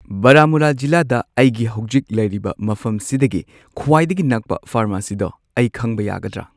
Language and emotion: Manipuri, neutral